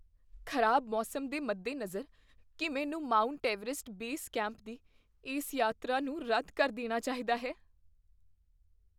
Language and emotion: Punjabi, fearful